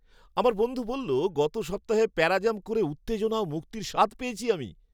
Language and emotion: Bengali, happy